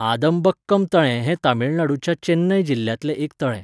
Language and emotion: Goan Konkani, neutral